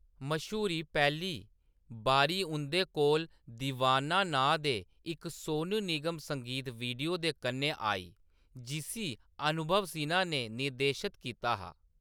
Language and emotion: Dogri, neutral